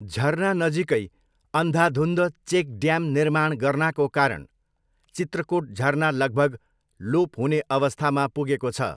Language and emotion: Nepali, neutral